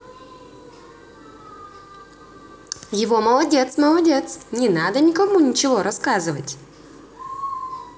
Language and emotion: Russian, positive